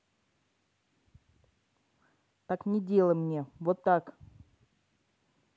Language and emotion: Russian, angry